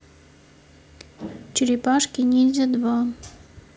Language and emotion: Russian, neutral